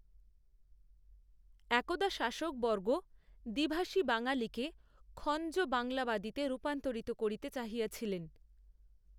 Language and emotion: Bengali, neutral